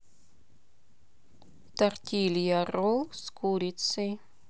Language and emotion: Russian, neutral